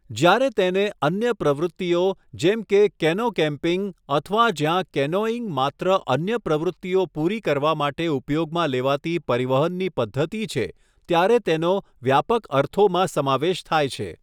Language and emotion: Gujarati, neutral